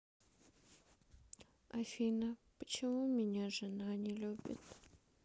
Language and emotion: Russian, sad